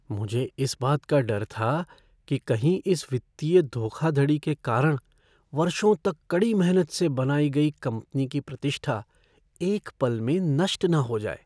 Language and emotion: Hindi, fearful